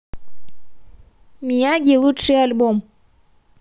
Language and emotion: Russian, positive